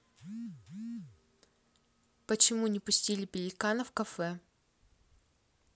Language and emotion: Russian, neutral